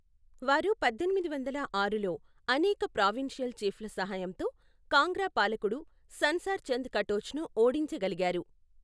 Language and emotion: Telugu, neutral